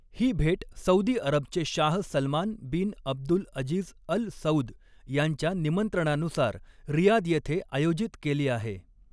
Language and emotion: Marathi, neutral